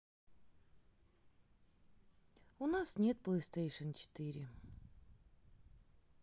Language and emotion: Russian, sad